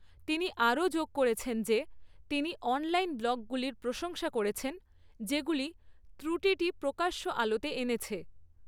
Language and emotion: Bengali, neutral